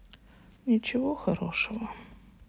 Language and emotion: Russian, sad